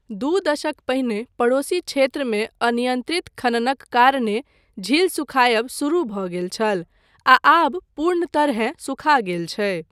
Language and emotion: Maithili, neutral